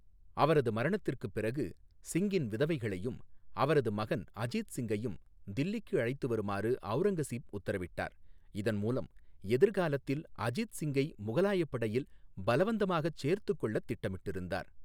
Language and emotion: Tamil, neutral